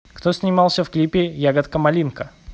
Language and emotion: Russian, neutral